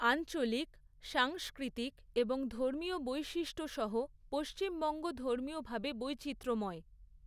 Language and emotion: Bengali, neutral